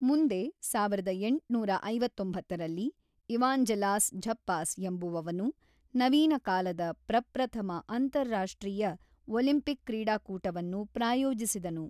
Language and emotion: Kannada, neutral